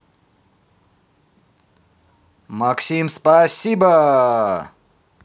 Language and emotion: Russian, positive